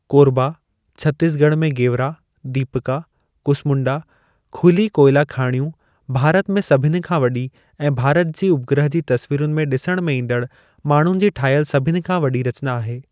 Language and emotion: Sindhi, neutral